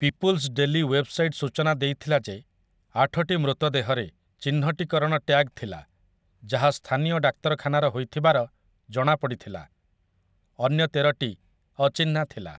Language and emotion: Odia, neutral